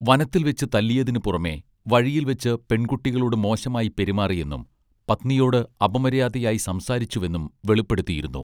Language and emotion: Malayalam, neutral